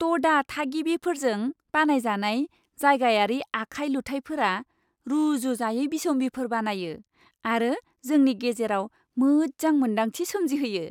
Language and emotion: Bodo, happy